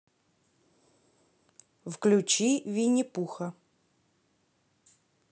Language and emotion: Russian, neutral